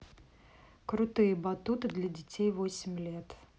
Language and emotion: Russian, neutral